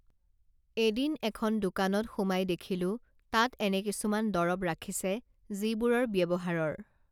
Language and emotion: Assamese, neutral